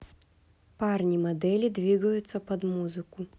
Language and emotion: Russian, neutral